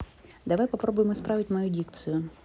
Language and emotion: Russian, neutral